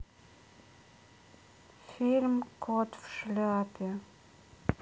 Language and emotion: Russian, sad